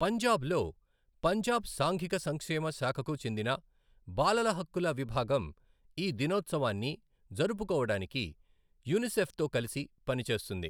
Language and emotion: Telugu, neutral